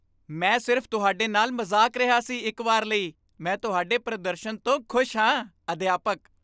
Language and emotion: Punjabi, happy